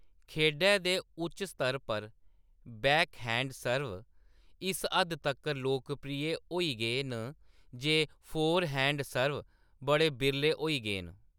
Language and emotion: Dogri, neutral